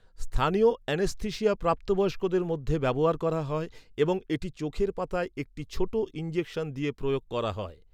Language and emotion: Bengali, neutral